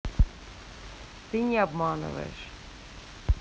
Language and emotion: Russian, neutral